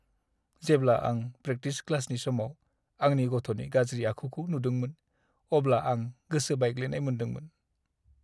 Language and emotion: Bodo, sad